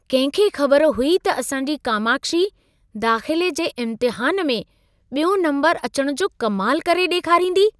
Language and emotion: Sindhi, surprised